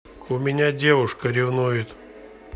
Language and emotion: Russian, neutral